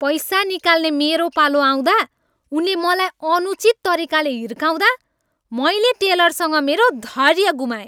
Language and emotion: Nepali, angry